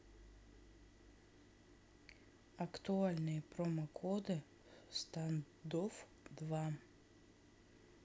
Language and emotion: Russian, neutral